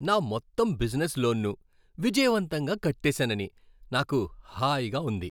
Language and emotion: Telugu, happy